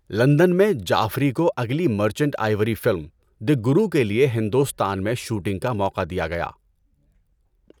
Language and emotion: Urdu, neutral